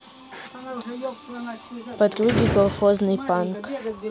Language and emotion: Russian, neutral